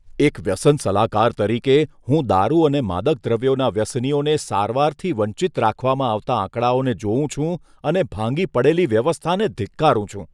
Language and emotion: Gujarati, disgusted